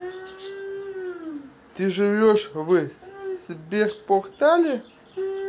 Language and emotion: Russian, neutral